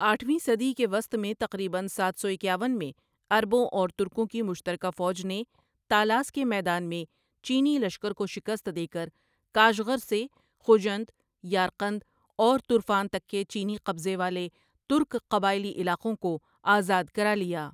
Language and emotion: Urdu, neutral